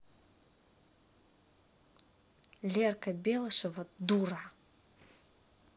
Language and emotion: Russian, angry